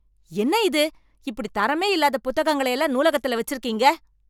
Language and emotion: Tamil, angry